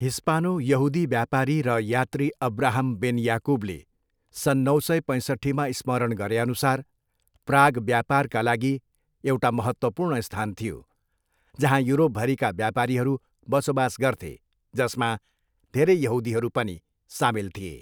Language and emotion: Nepali, neutral